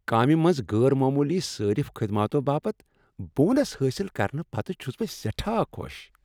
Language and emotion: Kashmiri, happy